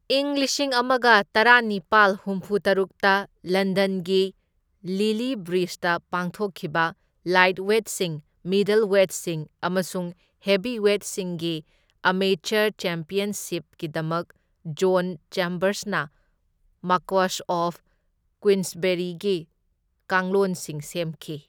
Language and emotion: Manipuri, neutral